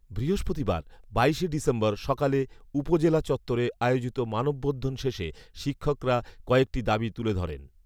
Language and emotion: Bengali, neutral